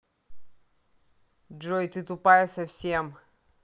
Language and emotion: Russian, angry